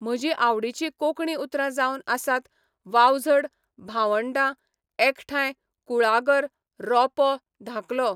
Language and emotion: Goan Konkani, neutral